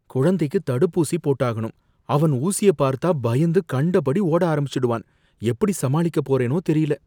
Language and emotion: Tamil, fearful